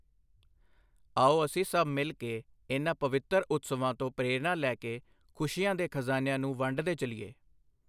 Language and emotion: Punjabi, neutral